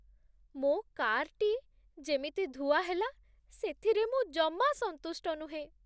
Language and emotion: Odia, sad